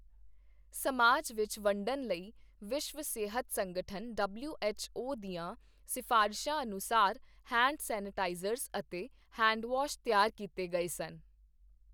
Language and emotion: Punjabi, neutral